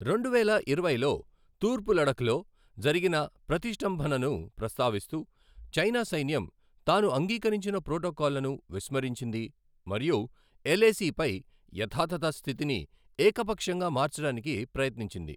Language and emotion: Telugu, neutral